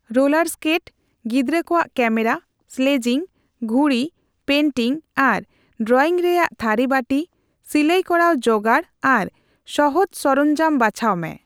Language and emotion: Santali, neutral